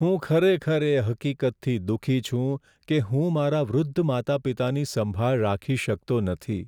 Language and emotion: Gujarati, sad